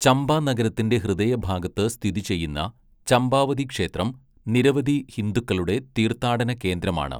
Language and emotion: Malayalam, neutral